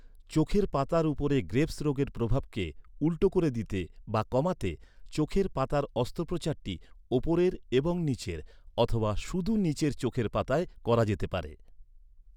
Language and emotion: Bengali, neutral